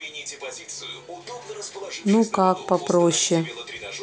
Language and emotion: Russian, neutral